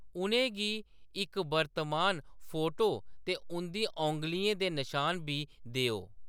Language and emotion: Dogri, neutral